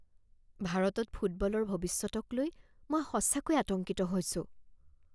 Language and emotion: Assamese, fearful